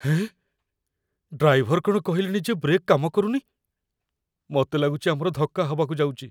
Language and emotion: Odia, fearful